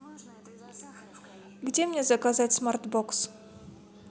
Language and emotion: Russian, neutral